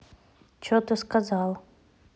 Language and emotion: Russian, neutral